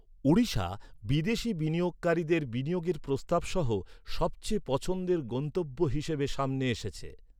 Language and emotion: Bengali, neutral